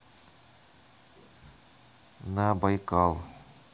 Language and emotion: Russian, neutral